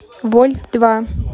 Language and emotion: Russian, neutral